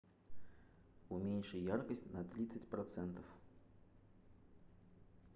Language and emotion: Russian, neutral